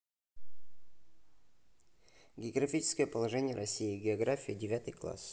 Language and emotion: Russian, neutral